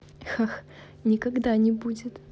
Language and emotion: Russian, positive